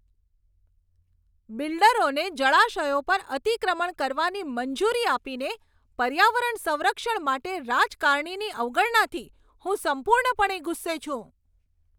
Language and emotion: Gujarati, angry